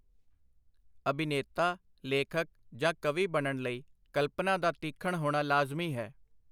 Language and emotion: Punjabi, neutral